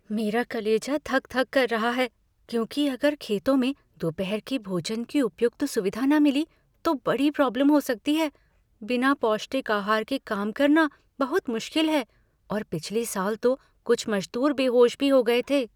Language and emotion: Hindi, fearful